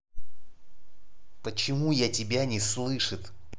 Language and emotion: Russian, angry